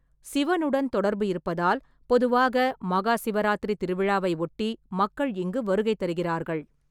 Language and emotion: Tamil, neutral